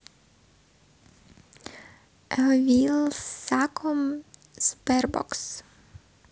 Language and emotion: Russian, neutral